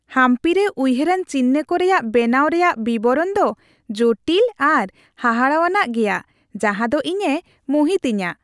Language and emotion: Santali, happy